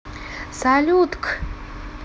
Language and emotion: Russian, positive